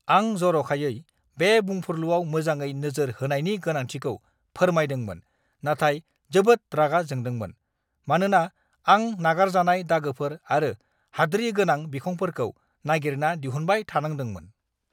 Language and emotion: Bodo, angry